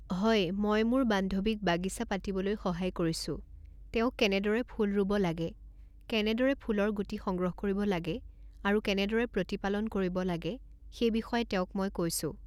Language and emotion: Assamese, neutral